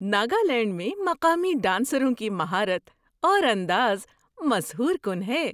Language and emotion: Urdu, surprised